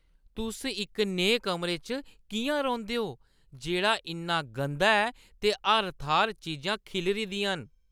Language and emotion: Dogri, disgusted